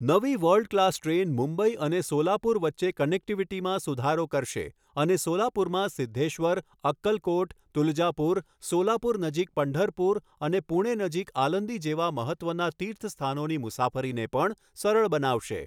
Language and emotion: Gujarati, neutral